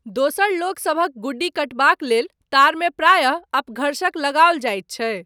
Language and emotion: Maithili, neutral